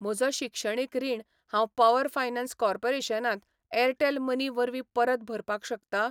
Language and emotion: Goan Konkani, neutral